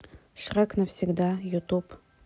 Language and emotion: Russian, neutral